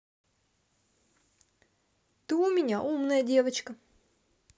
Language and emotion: Russian, neutral